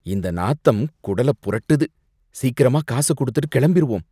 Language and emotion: Tamil, disgusted